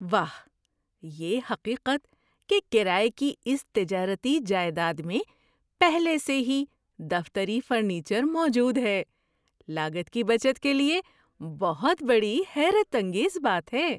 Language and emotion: Urdu, surprised